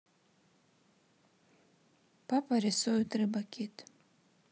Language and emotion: Russian, sad